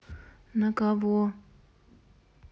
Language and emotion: Russian, neutral